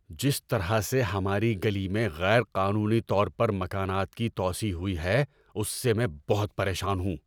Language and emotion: Urdu, angry